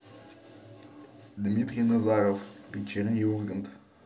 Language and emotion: Russian, neutral